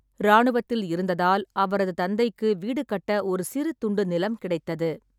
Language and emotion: Tamil, neutral